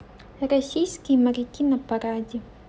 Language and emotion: Russian, neutral